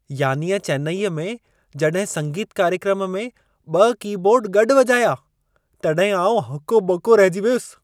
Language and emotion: Sindhi, surprised